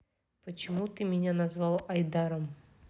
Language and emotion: Russian, neutral